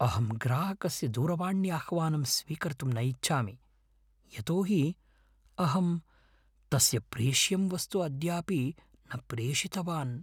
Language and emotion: Sanskrit, fearful